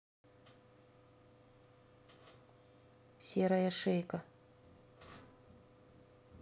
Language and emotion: Russian, neutral